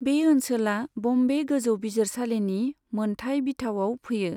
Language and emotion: Bodo, neutral